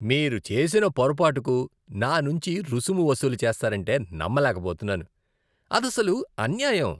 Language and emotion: Telugu, disgusted